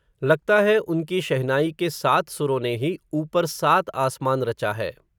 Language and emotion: Hindi, neutral